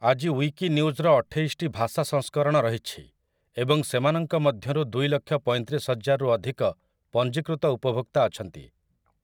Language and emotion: Odia, neutral